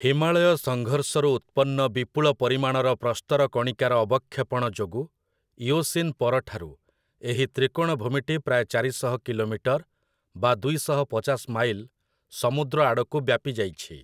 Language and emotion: Odia, neutral